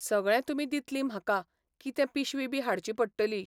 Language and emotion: Goan Konkani, neutral